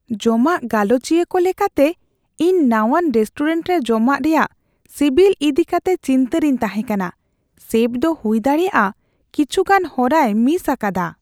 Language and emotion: Santali, fearful